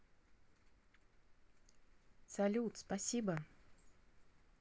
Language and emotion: Russian, positive